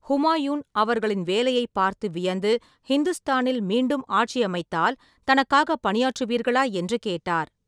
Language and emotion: Tamil, neutral